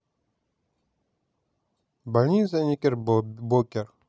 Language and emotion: Russian, neutral